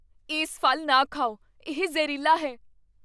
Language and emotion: Punjabi, fearful